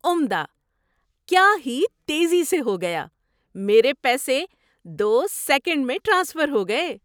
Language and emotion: Urdu, surprised